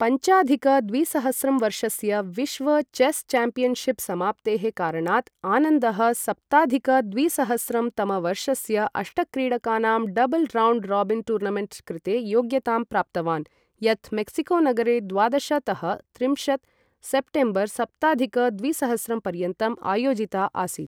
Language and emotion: Sanskrit, neutral